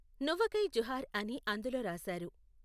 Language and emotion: Telugu, neutral